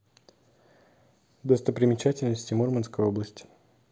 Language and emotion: Russian, neutral